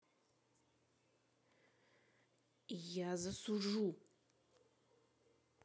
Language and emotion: Russian, angry